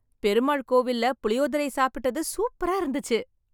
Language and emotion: Tamil, happy